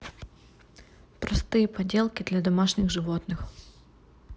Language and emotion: Russian, neutral